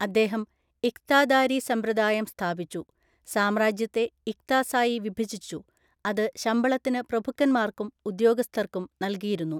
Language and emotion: Malayalam, neutral